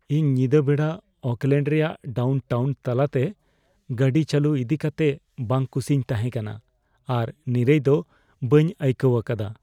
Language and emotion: Santali, fearful